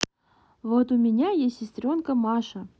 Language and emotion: Russian, neutral